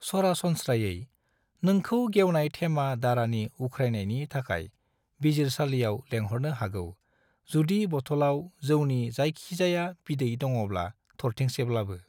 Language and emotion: Bodo, neutral